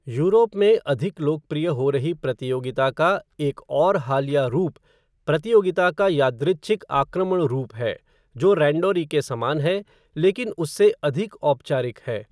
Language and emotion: Hindi, neutral